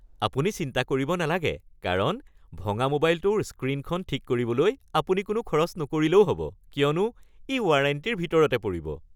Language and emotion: Assamese, happy